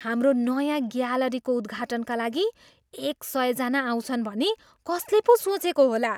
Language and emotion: Nepali, surprised